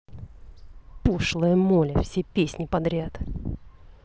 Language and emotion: Russian, angry